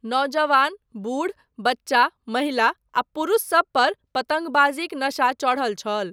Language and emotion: Maithili, neutral